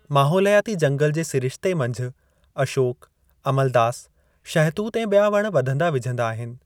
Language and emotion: Sindhi, neutral